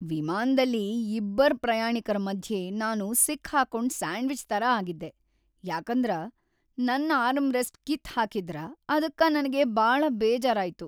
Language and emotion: Kannada, sad